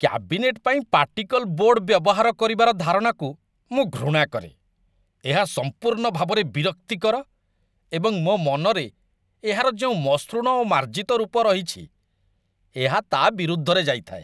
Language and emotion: Odia, disgusted